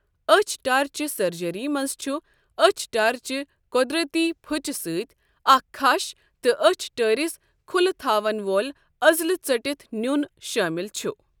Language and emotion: Kashmiri, neutral